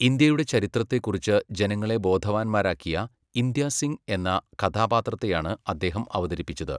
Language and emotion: Malayalam, neutral